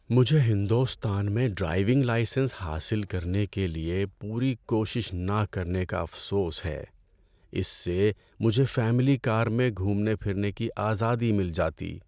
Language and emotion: Urdu, sad